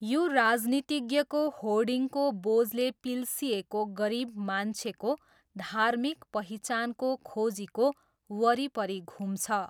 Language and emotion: Nepali, neutral